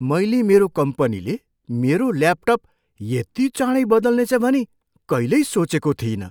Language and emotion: Nepali, surprised